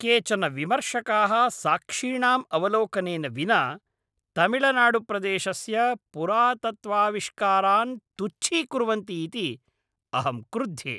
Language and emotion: Sanskrit, angry